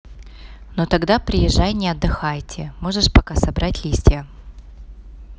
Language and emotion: Russian, neutral